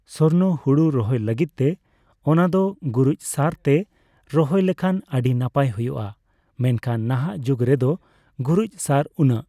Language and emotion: Santali, neutral